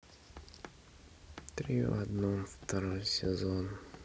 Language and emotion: Russian, sad